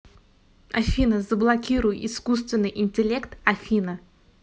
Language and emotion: Russian, neutral